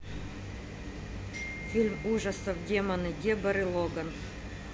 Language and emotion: Russian, neutral